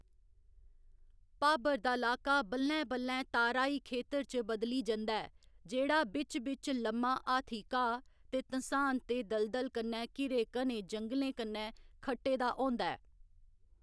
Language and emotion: Dogri, neutral